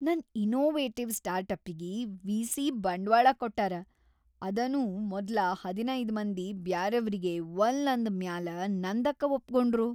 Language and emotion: Kannada, happy